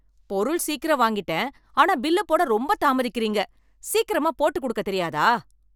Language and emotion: Tamil, angry